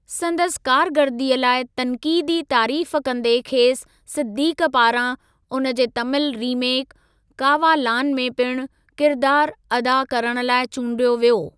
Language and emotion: Sindhi, neutral